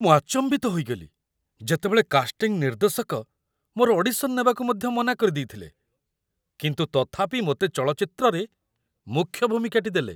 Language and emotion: Odia, surprised